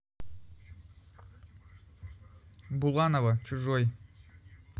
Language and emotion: Russian, neutral